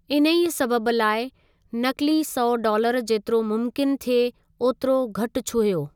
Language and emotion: Sindhi, neutral